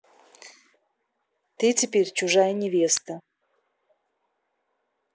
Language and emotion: Russian, neutral